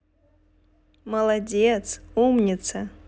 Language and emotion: Russian, positive